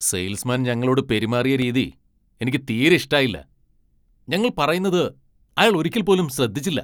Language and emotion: Malayalam, angry